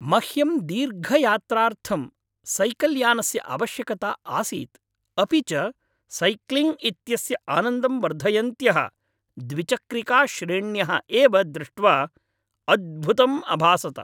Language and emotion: Sanskrit, happy